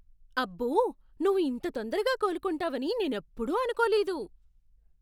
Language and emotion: Telugu, surprised